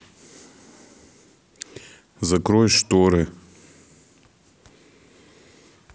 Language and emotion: Russian, neutral